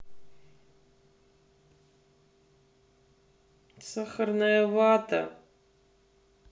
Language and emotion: Russian, sad